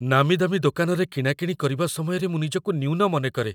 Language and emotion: Odia, fearful